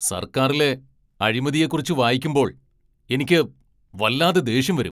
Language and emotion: Malayalam, angry